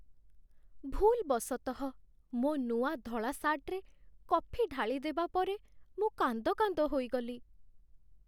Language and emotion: Odia, sad